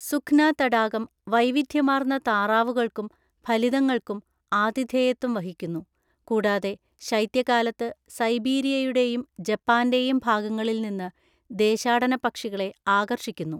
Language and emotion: Malayalam, neutral